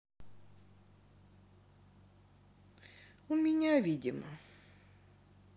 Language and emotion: Russian, sad